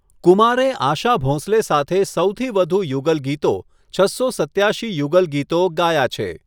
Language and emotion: Gujarati, neutral